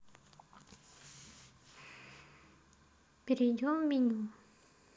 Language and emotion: Russian, neutral